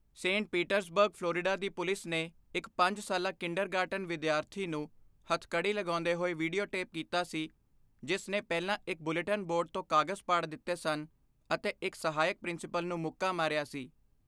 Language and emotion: Punjabi, neutral